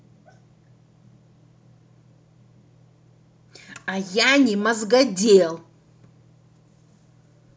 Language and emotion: Russian, angry